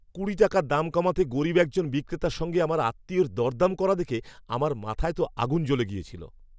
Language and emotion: Bengali, angry